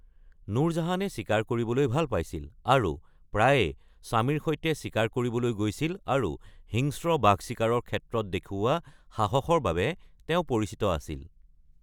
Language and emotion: Assamese, neutral